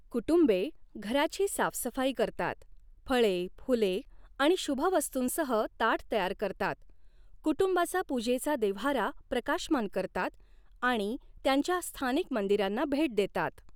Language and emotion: Marathi, neutral